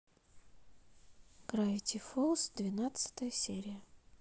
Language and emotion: Russian, neutral